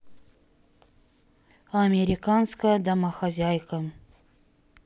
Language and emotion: Russian, neutral